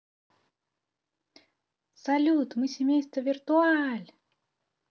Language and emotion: Russian, positive